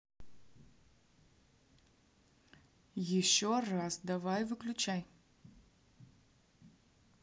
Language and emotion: Russian, angry